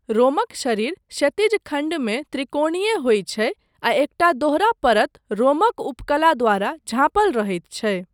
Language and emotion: Maithili, neutral